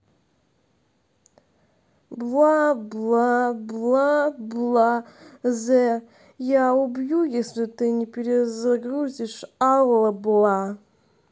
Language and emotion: Russian, sad